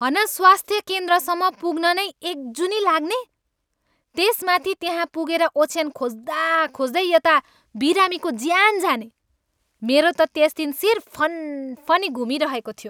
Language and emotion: Nepali, angry